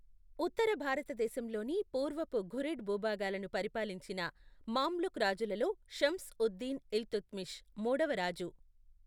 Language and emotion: Telugu, neutral